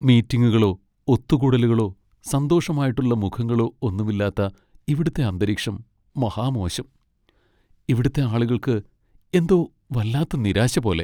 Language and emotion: Malayalam, sad